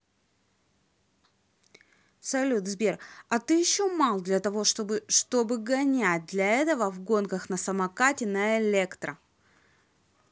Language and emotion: Russian, angry